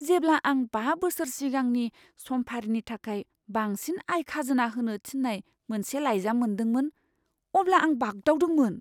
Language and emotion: Bodo, fearful